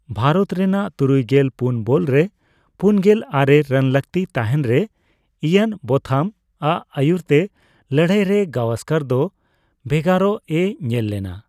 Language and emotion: Santali, neutral